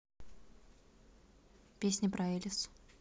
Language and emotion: Russian, neutral